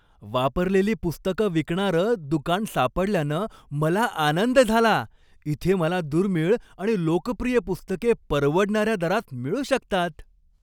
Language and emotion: Marathi, happy